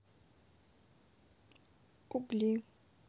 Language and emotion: Russian, neutral